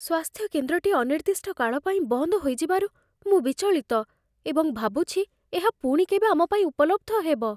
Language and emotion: Odia, fearful